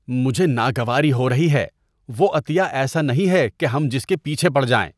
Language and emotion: Urdu, disgusted